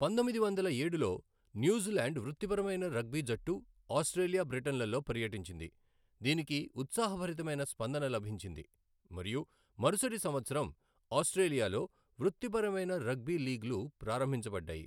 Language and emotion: Telugu, neutral